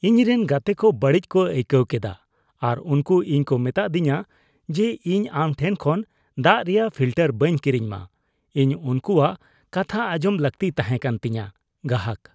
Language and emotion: Santali, disgusted